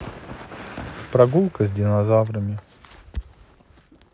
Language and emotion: Russian, neutral